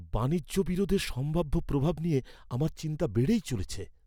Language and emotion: Bengali, fearful